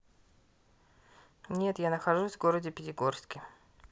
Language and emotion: Russian, neutral